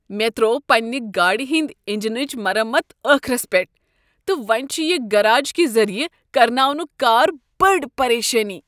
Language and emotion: Kashmiri, disgusted